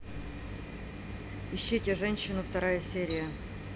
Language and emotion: Russian, neutral